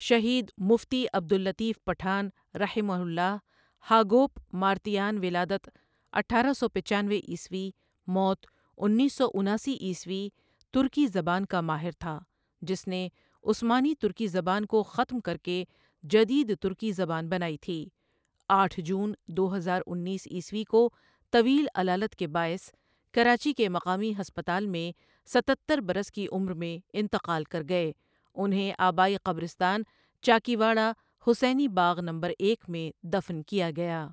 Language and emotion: Urdu, neutral